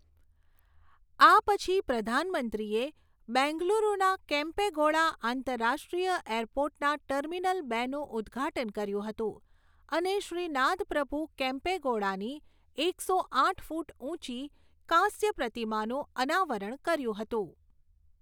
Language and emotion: Gujarati, neutral